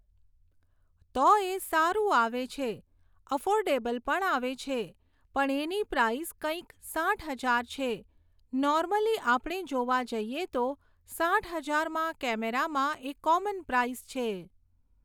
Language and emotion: Gujarati, neutral